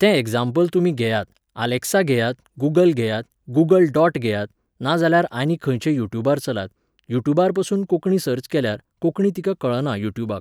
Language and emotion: Goan Konkani, neutral